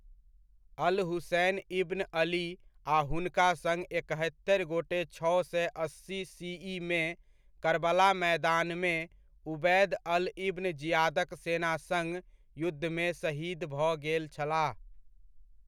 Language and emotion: Maithili, neutral